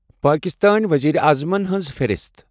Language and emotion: Kashmiri, neutral